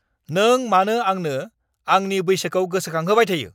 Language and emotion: Bodo, angry